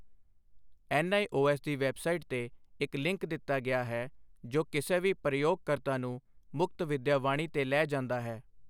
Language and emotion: Punjabi, neutral